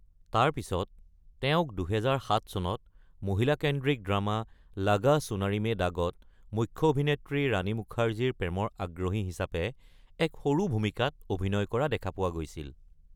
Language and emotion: Assamese, neutral